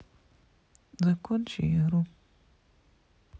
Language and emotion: Russian, neutral